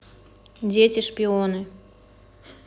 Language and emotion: Russian, neutral